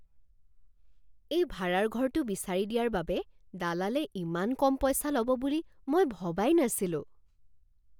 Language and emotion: Assamese, surprised